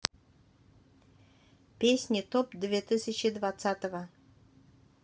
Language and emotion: Russian, neutral